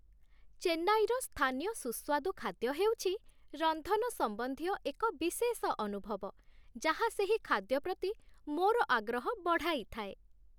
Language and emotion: Odia, happy